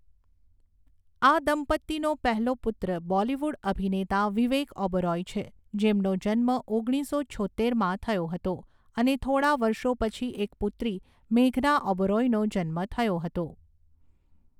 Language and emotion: Gujarati, neutral